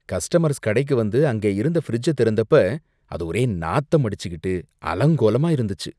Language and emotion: Tamil, disgusted